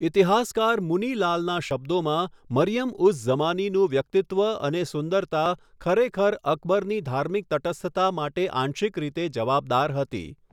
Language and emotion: Gujarati, neutral